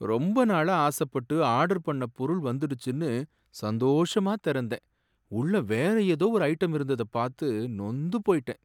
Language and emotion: Tamil, sad